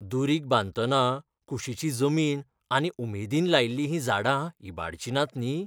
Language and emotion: Goan Konkani, fearful